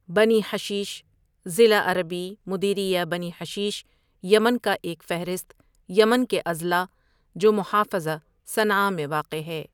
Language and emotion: Urdu, neutral